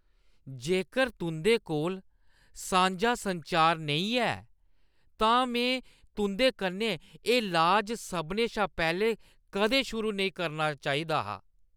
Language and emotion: Dogri, disgusted